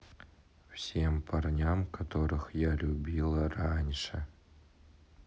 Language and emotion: Russian, neutral